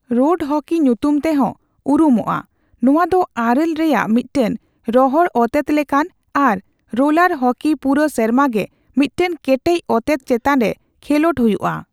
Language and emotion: Santali, neutral